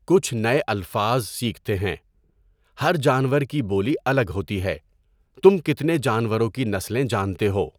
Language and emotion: Urdu, neutral